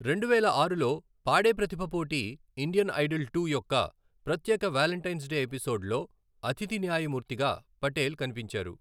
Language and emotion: Telugu, neutral